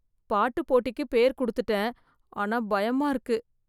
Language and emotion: Tamil, fearful